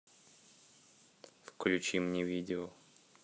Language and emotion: Russian, neutral